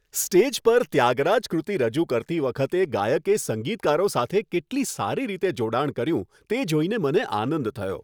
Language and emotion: Gujarati, happy